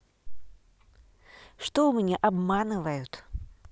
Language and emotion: Russian, neutral